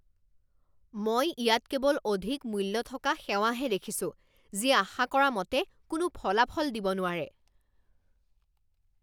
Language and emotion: Assamese, angry